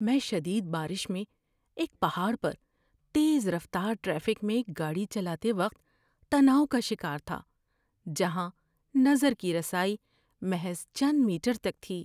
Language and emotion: Urdu, fearful